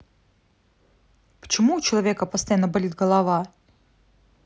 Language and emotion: Russian, neutral